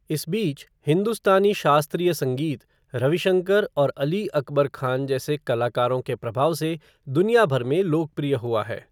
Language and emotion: Hindi, neutral